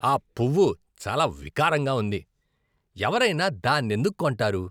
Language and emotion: Telugu, disgusted